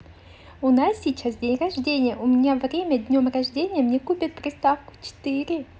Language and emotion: Russian, positive